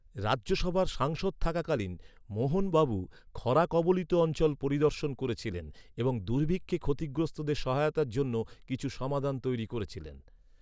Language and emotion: Bengali, neutral